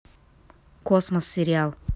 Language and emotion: Russian, neutral